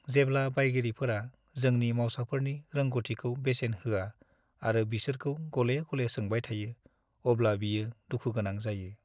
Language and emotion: Bodo, sad